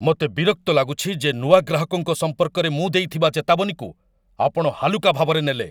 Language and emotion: Odia, angry